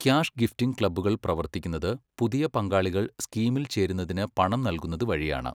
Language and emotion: Malayalam, neutral